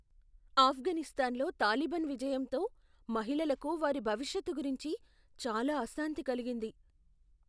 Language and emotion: Telugu, fearful